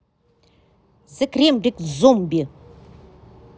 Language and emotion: Russian, angry